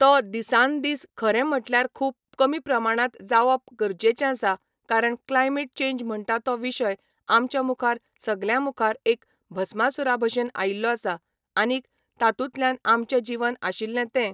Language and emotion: Goan Konkani, neutral